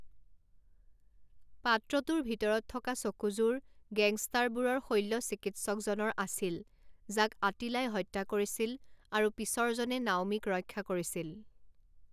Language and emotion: Assamese, neutral